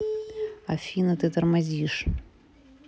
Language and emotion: Russian, neutral